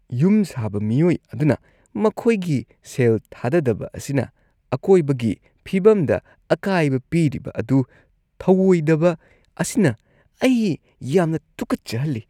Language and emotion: Manipuri, disgusted